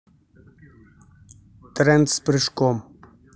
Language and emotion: Russian, neutral